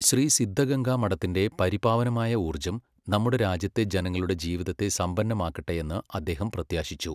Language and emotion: Malayalam, neutral